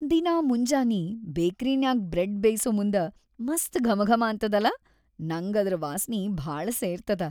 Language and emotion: Kannada, happy